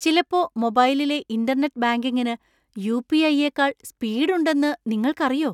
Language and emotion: Malayalam, surprised